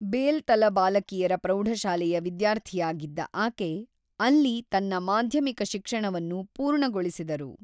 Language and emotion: Kannada, neutral